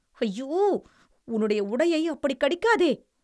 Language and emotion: Tamil, disgusted